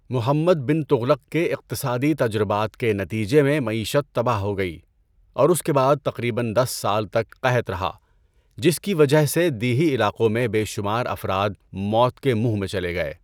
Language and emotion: Urdu, neutral